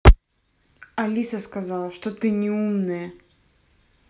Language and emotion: Russian, angry